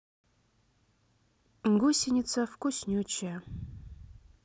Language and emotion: Russian, neutral